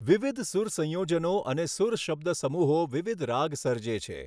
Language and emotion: Gujarati, neutral